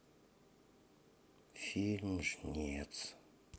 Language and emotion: Russian, sad